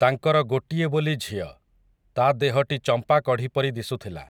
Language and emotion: Odia, neutral